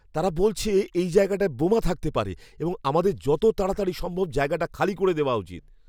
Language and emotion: Bengali, fearful